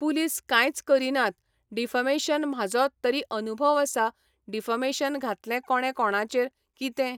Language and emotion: Goan Konkani, neutral